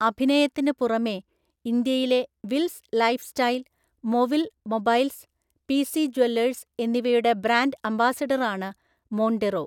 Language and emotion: Malayalam, neutral